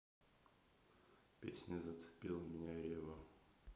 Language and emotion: Russian, neutral